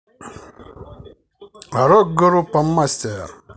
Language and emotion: Russian, positive